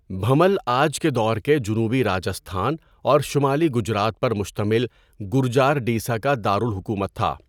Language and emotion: Urdu, neutral